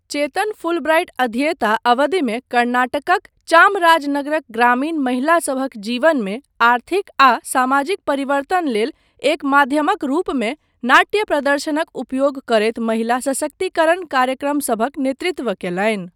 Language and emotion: Maithili, neutral